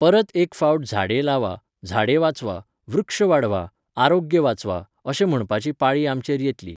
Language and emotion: Goan Konkani, neutral